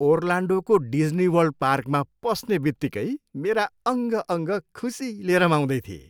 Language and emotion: Nepali, happy